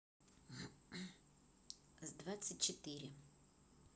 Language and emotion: Russian, neutral